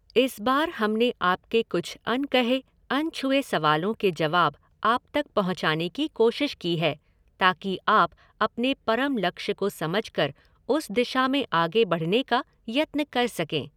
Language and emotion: Hindi, neutral